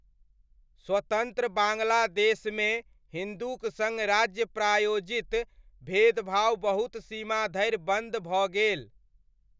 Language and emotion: Maithili, neutral